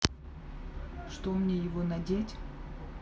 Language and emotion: Russian, neutral